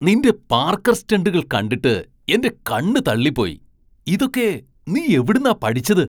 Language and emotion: Malayalam, surprised